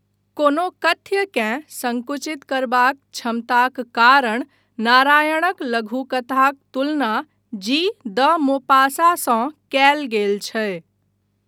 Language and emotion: Maithili, neutral